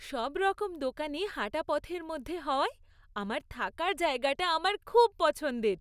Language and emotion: Bengali, happy